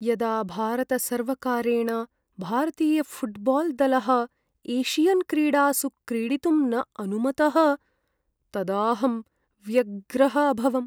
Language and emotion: Sanskrit, sad